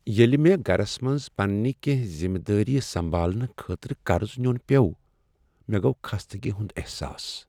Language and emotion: Kashmiri, sad